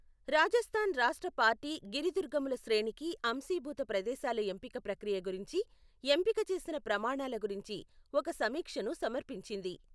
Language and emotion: Telugu, neutral